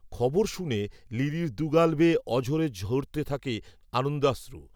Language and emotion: Bengali, neutral